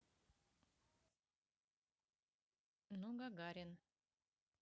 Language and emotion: Russian, neutral